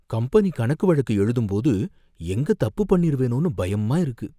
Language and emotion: Tamil, fearful